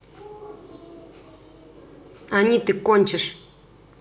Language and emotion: Russian, angry